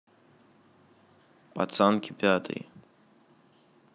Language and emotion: Russian, neutral